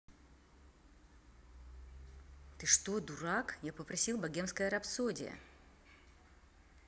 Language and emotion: Russian, angry